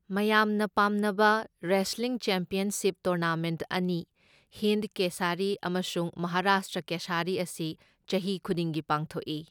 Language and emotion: Manipuri, neutral